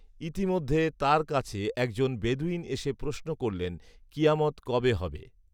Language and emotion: Bengali, neutral